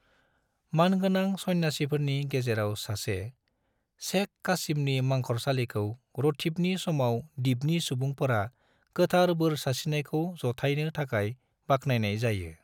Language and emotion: Bodo, neutral